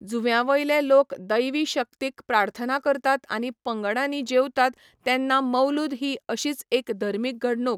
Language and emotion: Goan Konkani, neutral